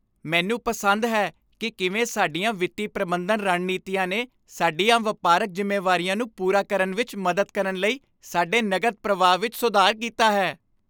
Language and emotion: Punjabi, happy